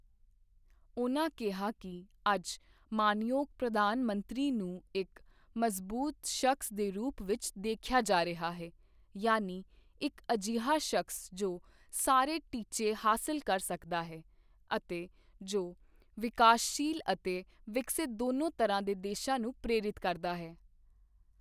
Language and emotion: Punjabi, neutral